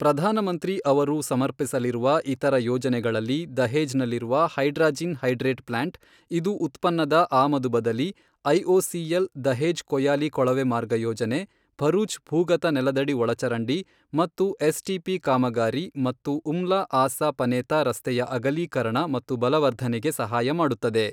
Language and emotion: Kannada, neutral